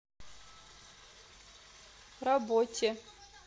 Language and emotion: Russian, neutral